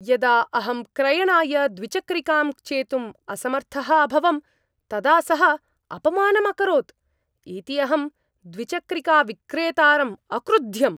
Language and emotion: Sanskrit, angry